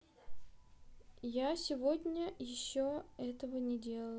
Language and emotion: Russian, neutral